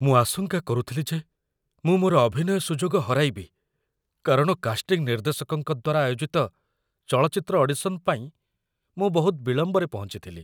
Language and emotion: Odia, fearful